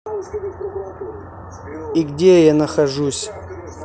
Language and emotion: Russian, neutral